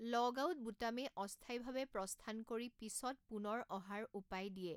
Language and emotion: Assamese, neutral